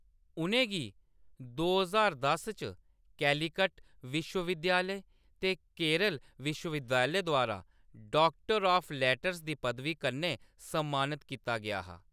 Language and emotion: Dogri, neutral